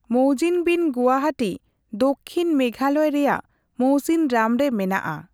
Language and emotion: Santali, neutral